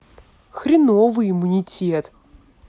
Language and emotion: Russian, angry